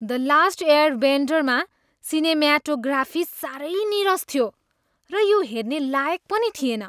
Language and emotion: Nepali, disgusted